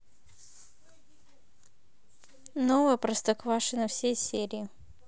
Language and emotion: Russian, neutral